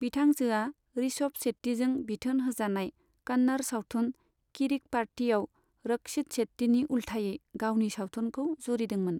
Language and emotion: Bodo, neutral